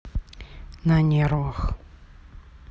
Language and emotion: Russian, neutral